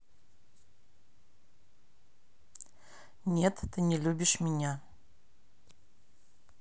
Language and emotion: Russian, neutral